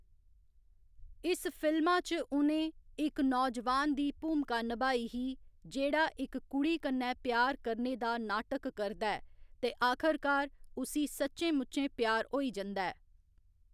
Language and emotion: Dogri, neutral